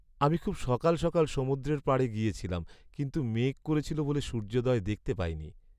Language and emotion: Bengali, sad